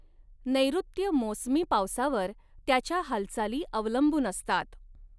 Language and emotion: Marathi, neutral